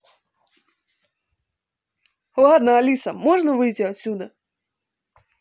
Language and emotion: Russian, neutral